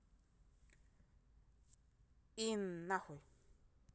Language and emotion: Russian, neutral